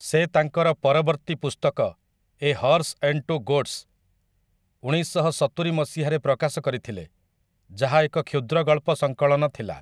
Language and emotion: Odia, neutral